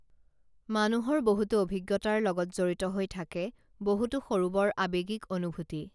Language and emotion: Assamese, neutral